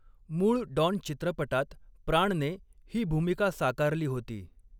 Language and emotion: Marathi, neutral